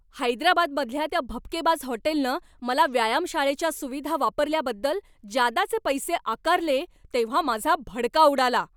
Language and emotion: Marathi, angry